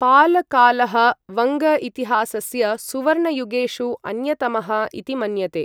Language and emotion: Sanskrit, neutral